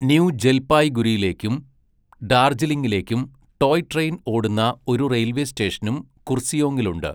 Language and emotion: Malayalam, neutral